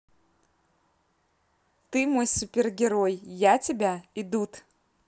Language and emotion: Russian, positive